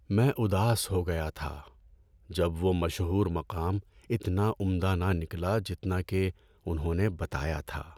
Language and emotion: Urdu, sad